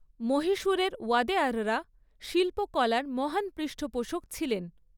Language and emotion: Bengali, neutral